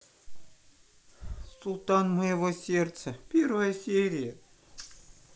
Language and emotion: Russian, sad